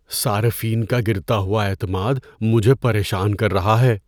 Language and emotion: Urdu, fearful